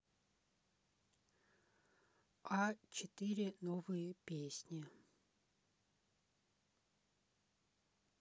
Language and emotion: Russian, neutral